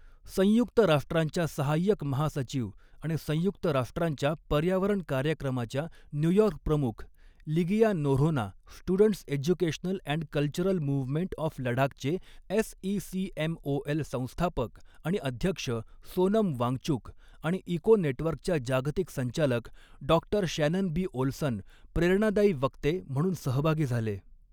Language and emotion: Marathi, neutral